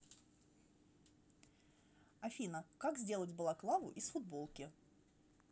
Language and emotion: Russian, neutral